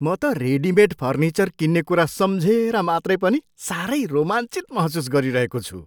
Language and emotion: Nepali, surprised